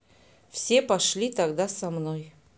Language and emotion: Russian, neutral